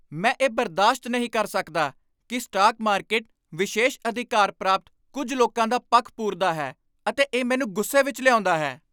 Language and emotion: Punjabi, angry